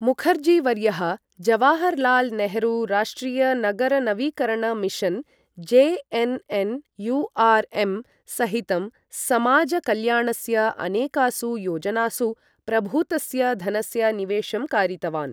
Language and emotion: Sanskrit, neutral